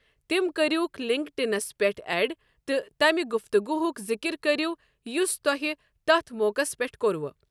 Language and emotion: Kashmiri, neutral